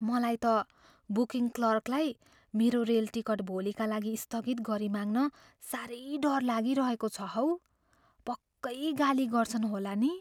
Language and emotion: Nepali, fearful